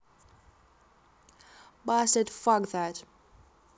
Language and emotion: Russian, neutral